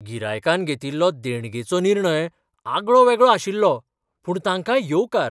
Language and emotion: Goan Konkani, surprised